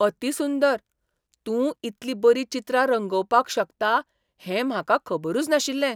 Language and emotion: Goan Konkani, surprised